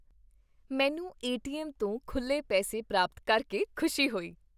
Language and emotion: Punjabi, happy